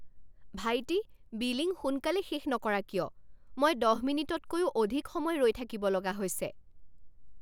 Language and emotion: Assamese, angry